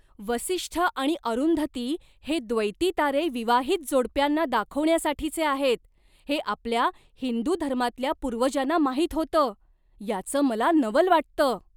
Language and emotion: Marathi, surprised